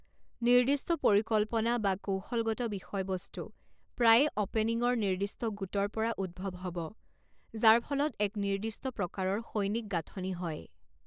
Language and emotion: Assamese, neutral